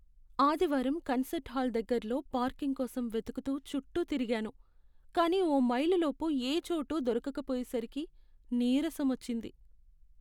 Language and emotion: Telugu, sad